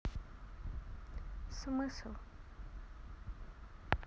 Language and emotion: Russian, neutral